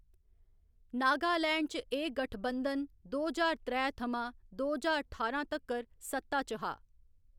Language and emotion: Dogri, neutral